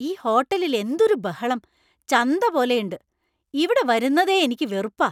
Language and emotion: Malayalam, angry